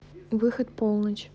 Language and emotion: Russian, neutral